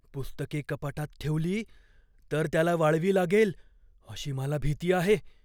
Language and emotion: Marathi, fearful